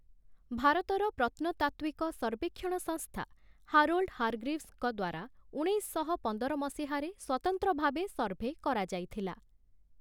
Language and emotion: Odia, neutral